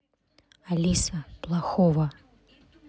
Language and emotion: Russian, neutral